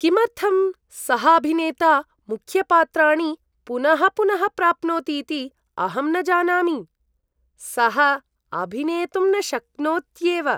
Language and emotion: Sanskrit, disgusted